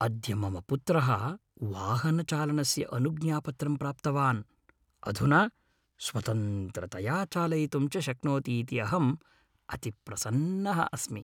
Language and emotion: Sanskrit, happy